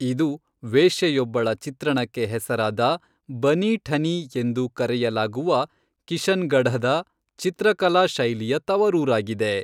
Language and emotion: Kannada, neutral